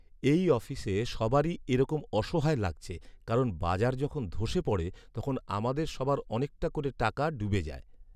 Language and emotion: Bengali, sad